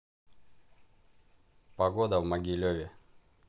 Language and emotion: Russian, neutral